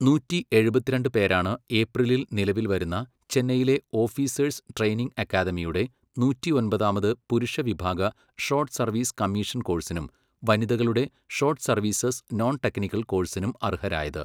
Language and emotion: Malayalam, neutral